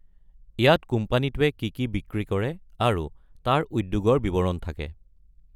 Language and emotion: Assamese, neutral